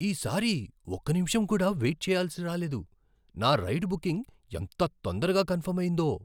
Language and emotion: Telugu, surprised